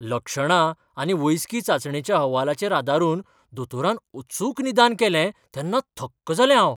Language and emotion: Goan Konkani, surprised